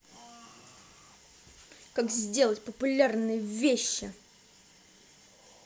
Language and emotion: Russian, angry